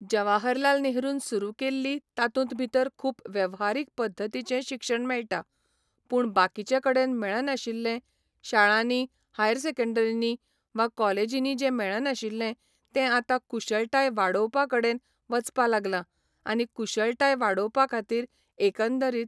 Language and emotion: Goan Konkani, neutral